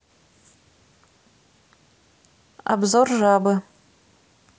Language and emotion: Russian, neutral